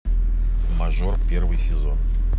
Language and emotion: Russian, neutral